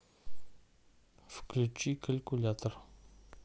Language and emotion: Russian, neutral